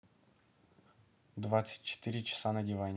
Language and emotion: Russian, neutral